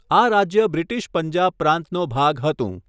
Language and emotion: Gujarati, neutral